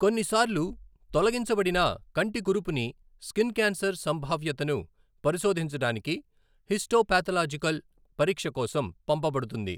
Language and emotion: Telugu, neutral